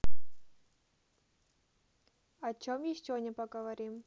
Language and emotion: Russian, neutral